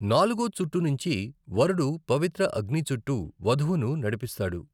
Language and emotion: Telugu, neutral